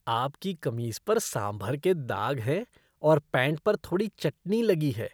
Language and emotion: Hindi, disgusted